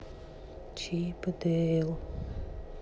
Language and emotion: Russian, sad